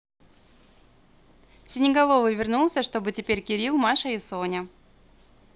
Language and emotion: Russian, positive